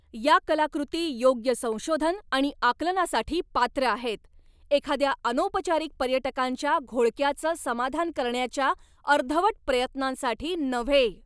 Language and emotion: Marathi, angry